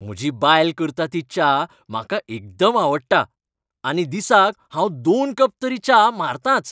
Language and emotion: Goan Konkani, happy